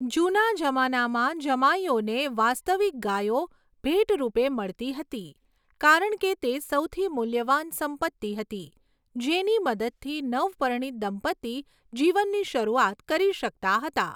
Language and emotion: Gujarati, neutral